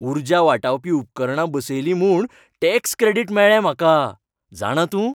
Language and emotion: Goan Konkani, happy